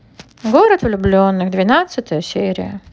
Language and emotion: Russian, neutral